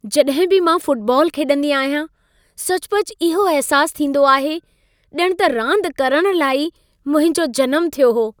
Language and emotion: Sindhi, happy